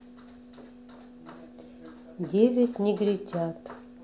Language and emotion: Russian, sad